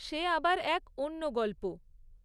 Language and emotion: Bengali, neutral